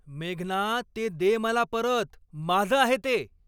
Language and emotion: Marathi, angry